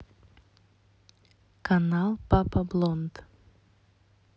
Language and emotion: Russian, neutral